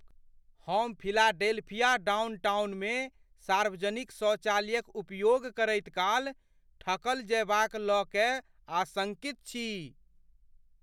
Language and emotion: Maithili, fearful